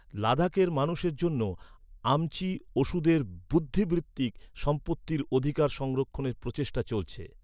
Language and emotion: Bengali, neutral